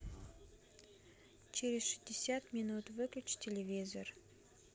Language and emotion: Russian, neutral